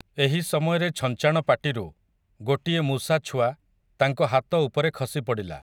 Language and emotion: Odia, neutral